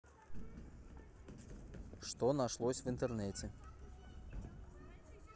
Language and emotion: Russian, neutral